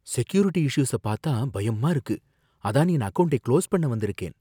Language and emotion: Tamil, fearful